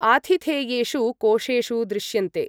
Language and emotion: Sanskrit, neutral